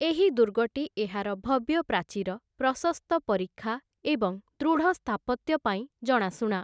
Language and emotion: Odia, neutral